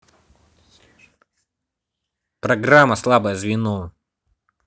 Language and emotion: Russian, angry